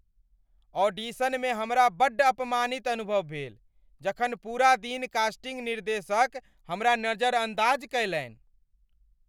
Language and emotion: Maithili, angry